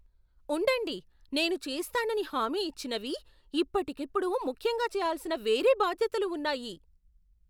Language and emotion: Telugu, surprised